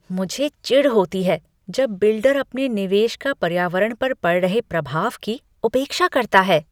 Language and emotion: Hindi, disgusted